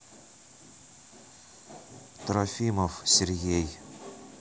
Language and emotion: Russian, neutral